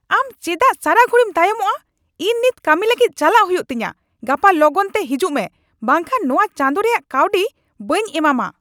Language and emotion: Santali, angry